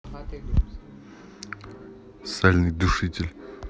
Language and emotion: Russian, neutral